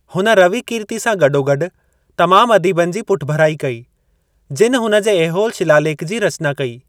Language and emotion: Sindhi, neutral